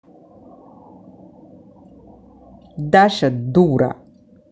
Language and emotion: Russian, angry